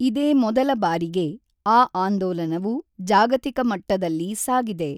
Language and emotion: Kannada, neutral